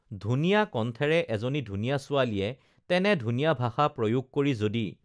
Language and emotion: Assamese, neutral